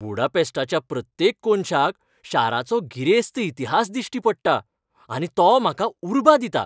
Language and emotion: Goan Konkani, happy